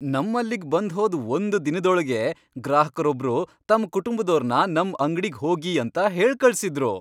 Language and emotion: Kannada, happy